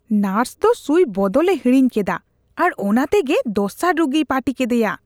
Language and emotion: Santali, disgusted